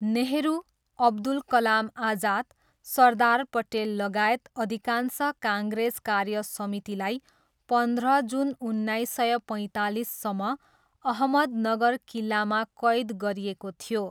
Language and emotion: Nepali, neutral